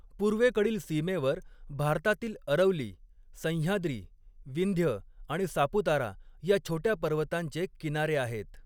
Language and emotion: Marathi, neutral